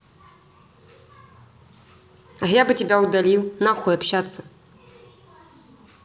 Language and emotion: Russian, angry